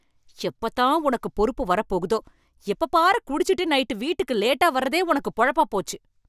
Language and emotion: Tamil, angry